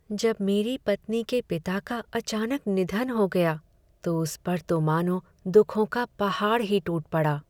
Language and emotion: Hindi, sad